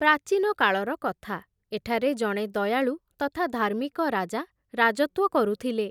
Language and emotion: Odia, neutral